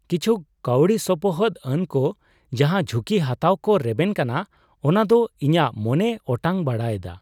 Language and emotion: Santali, surprised